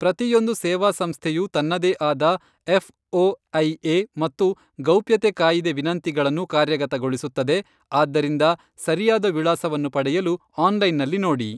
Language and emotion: Kannada, neutral